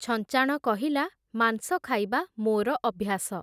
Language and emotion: Odia, neutral